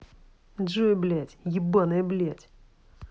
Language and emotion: Russian, angry